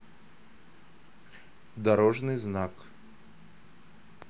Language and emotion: Russian, neutral